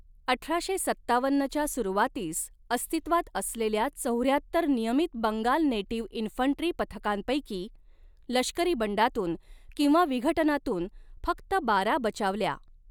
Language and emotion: Marathi, neutral